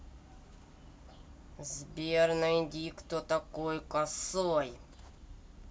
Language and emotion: Russian, angry